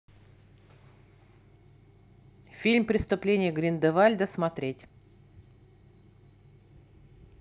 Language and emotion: Russian, neutral